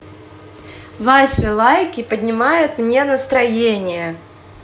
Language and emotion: Russian, positive